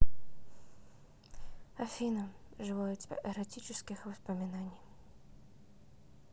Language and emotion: Russian, neutral